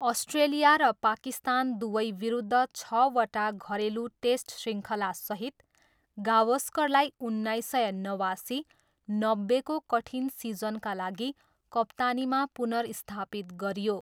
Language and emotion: Nepali, neutral